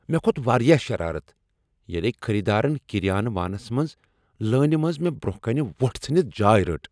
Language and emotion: Kashmiri, angry